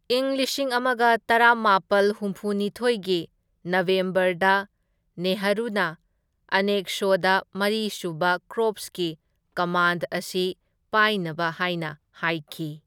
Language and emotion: Manipuri, neutral